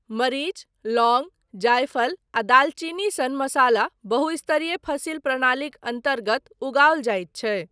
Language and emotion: Maithili, neutral